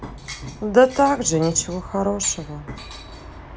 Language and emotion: Russian, sad